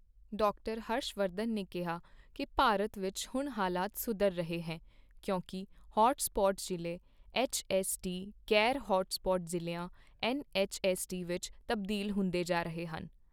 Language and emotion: Punjabi, neutral